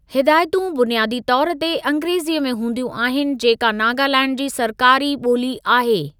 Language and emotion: Sindhi, neutral